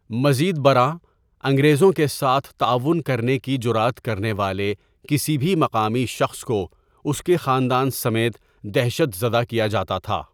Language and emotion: Urdu, neutral